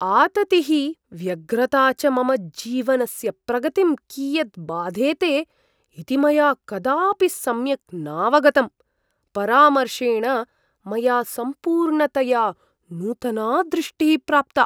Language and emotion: Sanskrit, surprised